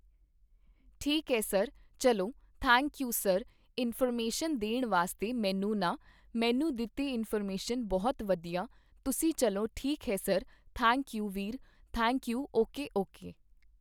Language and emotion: Punjabi, neutral